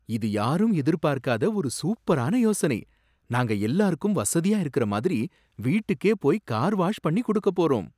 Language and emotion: Tamil, surprised